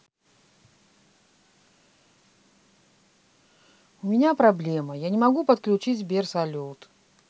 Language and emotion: Russian, neutral